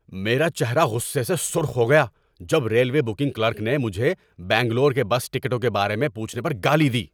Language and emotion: Urdu, angry